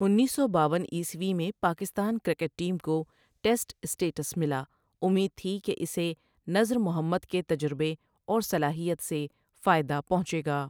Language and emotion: Urdu, neutral